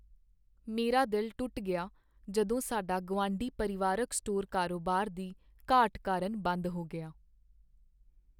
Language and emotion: Punjabi, sad